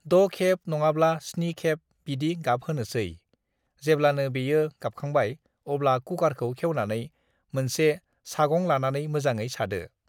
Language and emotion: Bodo, neutral